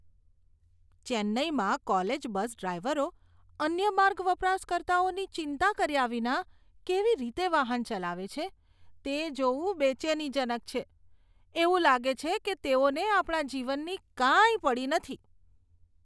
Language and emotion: Gujarati, disgusted